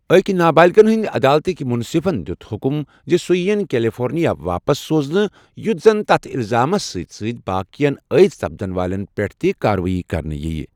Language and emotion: Kashmiri, neutral